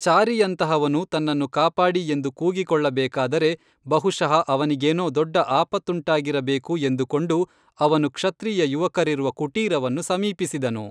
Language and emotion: Kannada, neutral